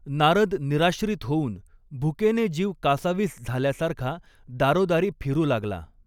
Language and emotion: Marathi, neutral